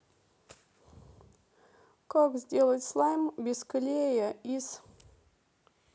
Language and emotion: Russian, sad